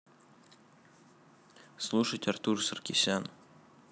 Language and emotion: Russian, neutral